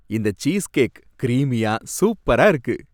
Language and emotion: Tamil, happy